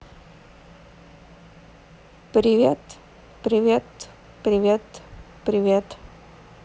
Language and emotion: Russian, neutral